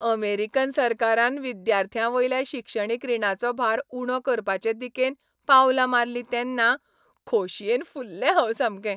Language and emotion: Goan Konkani, happy